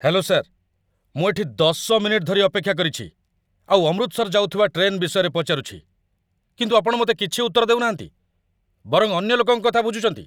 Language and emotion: Odia, angry